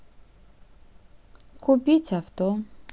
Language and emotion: Russian, neutral